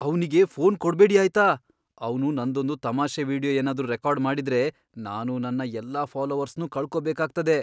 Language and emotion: Kannada, fearful